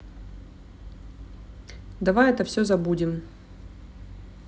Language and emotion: Russian, neutral